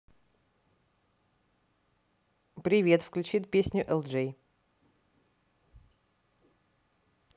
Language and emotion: Russian, positive